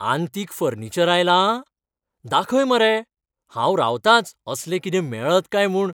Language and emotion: Goan Konkani, happy